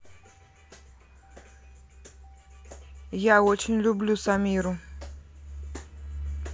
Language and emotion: Russian, neutral